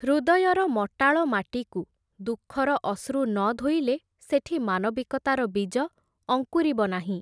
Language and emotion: Odia, neutral